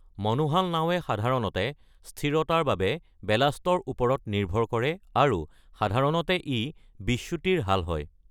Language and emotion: Assamese, neutral